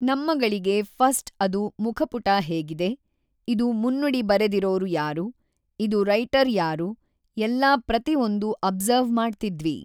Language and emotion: Kannada, neutral